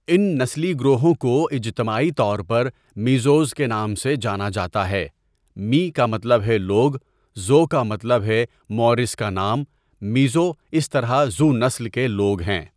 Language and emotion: Urdu, neutral